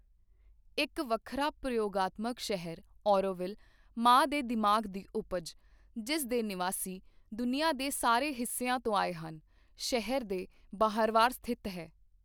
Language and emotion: Punjabi, neutral